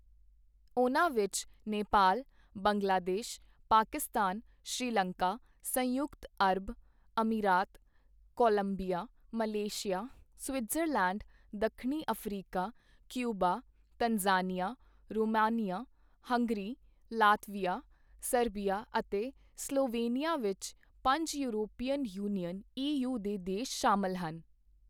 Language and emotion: Punjabi, neutral